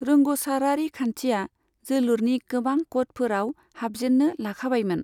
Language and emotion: Bodo, neutral